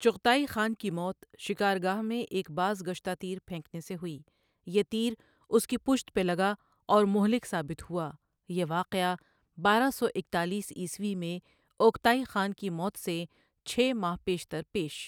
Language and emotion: Urdu, neutral